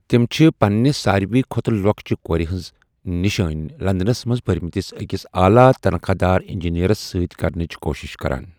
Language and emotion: Kashmiri, neutral